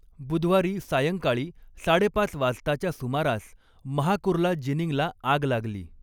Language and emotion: Marathi, neutral